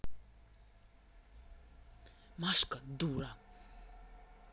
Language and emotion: Russian, angry